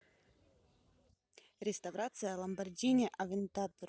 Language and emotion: Russian, neutral